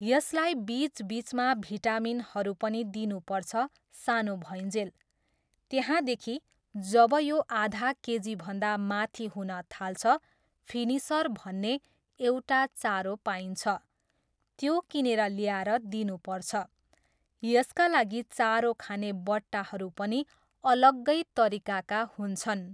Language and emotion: Nepali, neutral